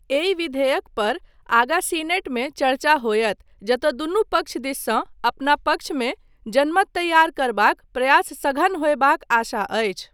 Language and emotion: Maithili, neutral